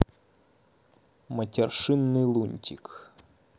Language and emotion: Russian, neutral